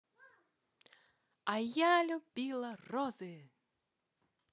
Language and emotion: Russian, positive